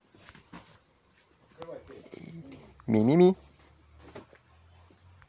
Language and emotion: Russian, positive